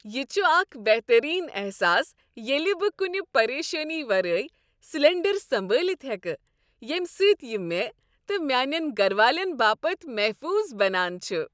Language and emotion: Kashmiri, happy